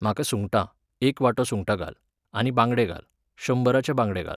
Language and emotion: Goan Konkani, neutral